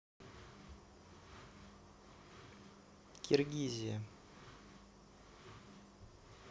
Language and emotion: Russian, neutral